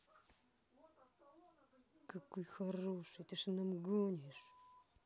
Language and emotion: Russian, angry